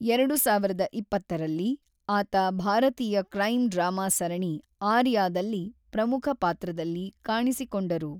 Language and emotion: Kannada, neutral